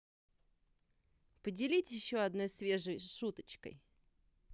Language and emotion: Russian, positive